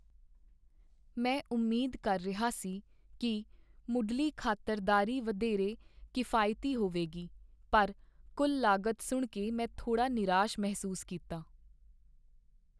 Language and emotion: Punjabi, sad